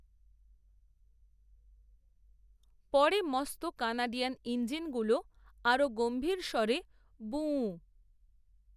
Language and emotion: Bengali, neutral